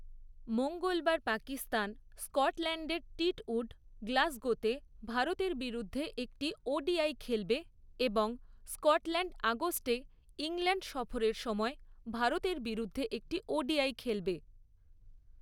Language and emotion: Bengali, neutral